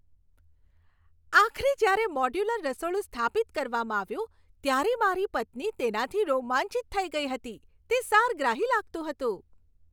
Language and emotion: Gujarati, happy